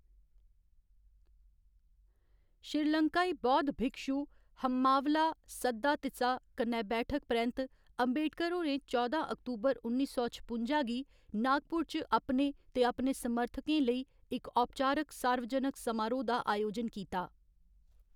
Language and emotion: Dogri, neutral